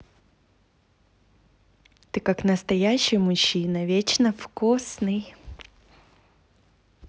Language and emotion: Russian, positive